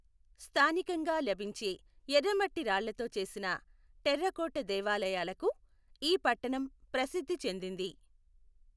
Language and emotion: Telugu, neutral